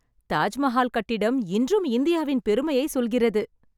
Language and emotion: Tamil, happy